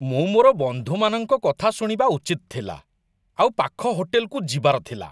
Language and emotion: Odia, disgusted